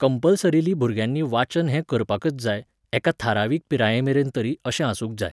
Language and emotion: Goan Konkani, neutral